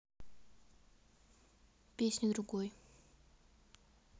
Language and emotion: Russian, neutral